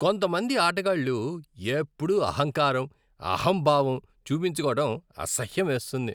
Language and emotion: Telugu, disgusted